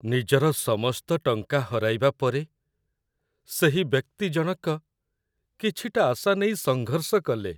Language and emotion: Odia, sad